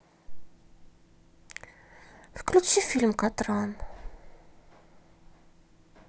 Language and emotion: Russian, sad